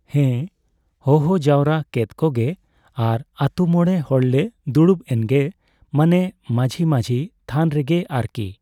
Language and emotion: Santali, neutral